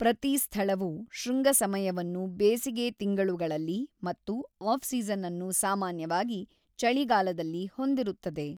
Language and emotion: Kannada, neutral